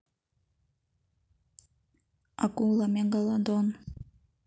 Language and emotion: Russian, neutral